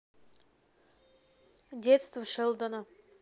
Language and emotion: Russian, neutral